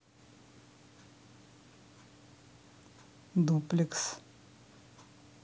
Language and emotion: Russian, neutral